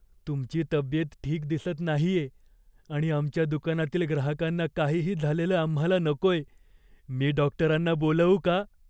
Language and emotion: Marathi, fearful